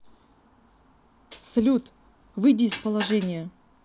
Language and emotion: Russian, angry